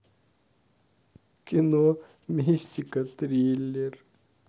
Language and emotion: Russian, sad